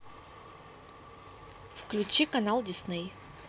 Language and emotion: Russian, neutral